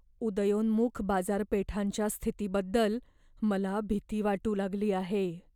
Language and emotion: Marathi, fearful